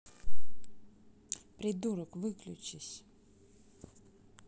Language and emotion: Russian, angry